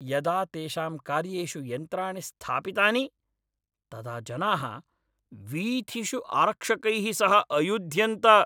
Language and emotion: Sanskrit, angry